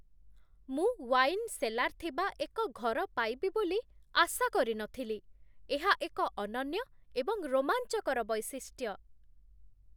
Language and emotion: Odia, surprised